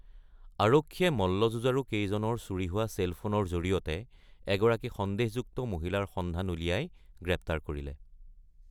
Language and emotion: Assamese, neutral